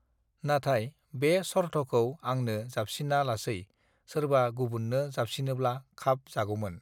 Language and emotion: Bodo, neutral